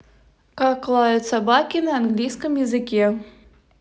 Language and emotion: Russian, neutral